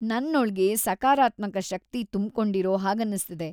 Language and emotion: Kannada, happy